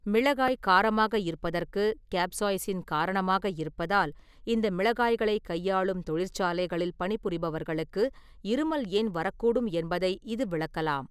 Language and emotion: Tamil, neutral